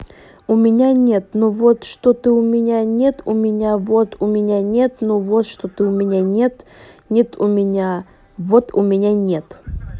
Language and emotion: Russian, neutral